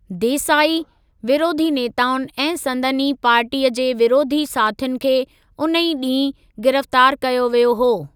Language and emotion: Sindhi, neutral